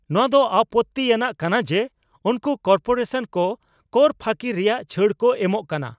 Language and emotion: Santali, angry